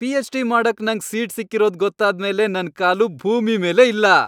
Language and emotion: Kannada, happy